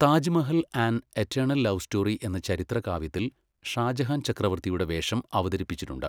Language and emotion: Malayalam, neutral